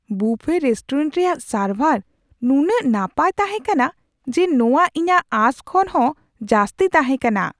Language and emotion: Santali, surprised